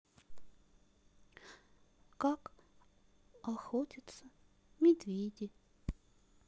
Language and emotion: Russian, sad